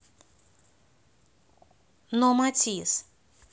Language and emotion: Russian, neutral